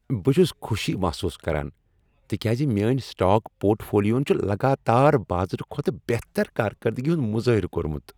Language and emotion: Kashmiri, happy